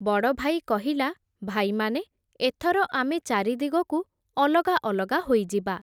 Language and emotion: Odia, neutral